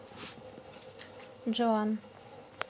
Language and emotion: Russian, neutral